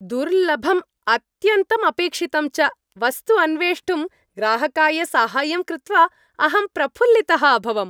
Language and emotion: Sanskrit, happy